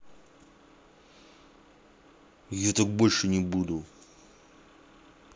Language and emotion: Russian, angry